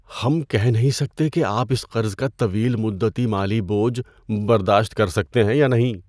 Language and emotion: Urdu, fearful